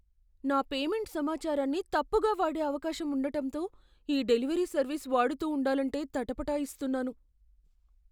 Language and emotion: Telugu, fearful